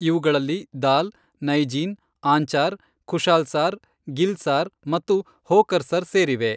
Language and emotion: Kannada, neutral